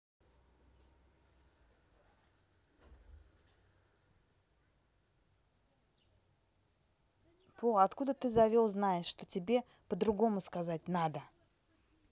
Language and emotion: Russian, neutral